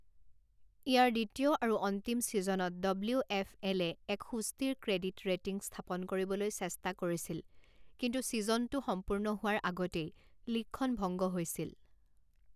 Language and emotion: Assamese, neutral